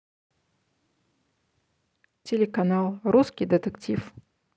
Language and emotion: Russian, neutral